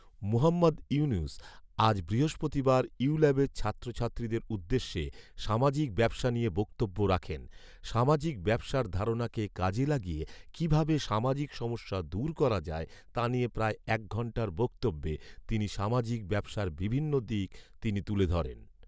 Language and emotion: Bengali, neutral